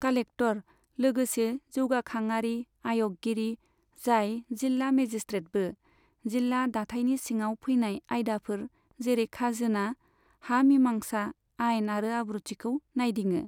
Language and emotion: Bodo, neutral